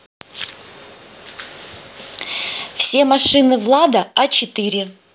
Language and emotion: Russian, neutral